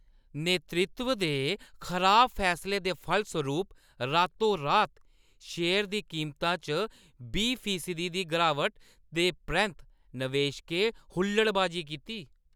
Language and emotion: Dogri, angry